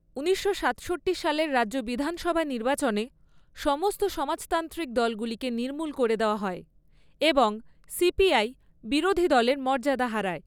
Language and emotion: Bengali, neutral